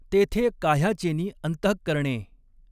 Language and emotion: Marathi, neutral